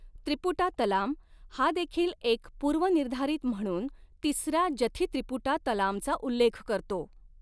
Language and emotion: Marathi, neutral